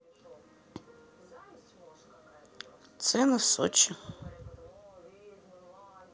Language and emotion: Russian, neutral